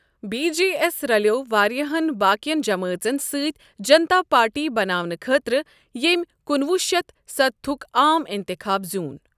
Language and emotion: Kashmiri, neutral